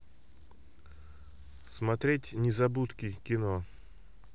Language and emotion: Russian, neutral